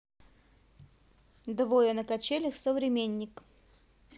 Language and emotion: Russian, neutral